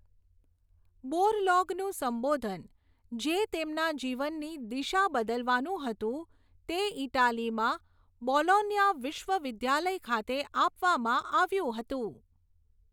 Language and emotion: Gujarati, neutral